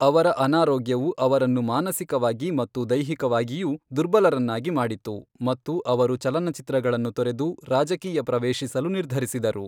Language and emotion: Kannada, neutral